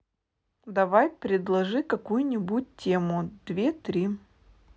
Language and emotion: Russian, neutral